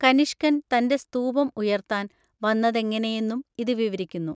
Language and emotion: Malayalam, neutral